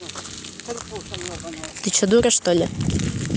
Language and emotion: Russian, neutral